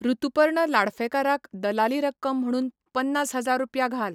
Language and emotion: Goan Konkani, neutral